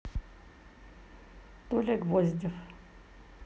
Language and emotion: Russian, neutral